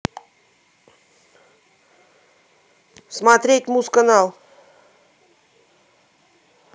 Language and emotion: Russian, positive